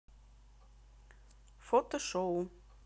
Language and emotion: Russian, neutral